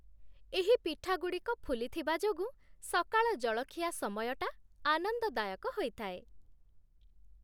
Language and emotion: Odia, happy